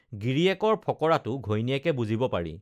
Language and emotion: Assamese, neutral